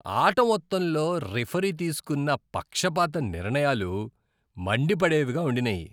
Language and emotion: Telugu, disgusted